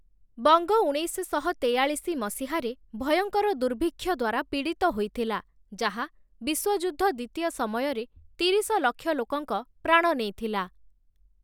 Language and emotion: Odia, neutral